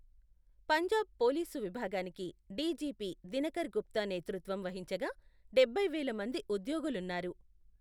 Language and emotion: Telugu, neutral